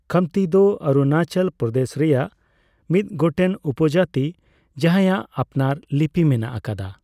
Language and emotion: Santali, neutral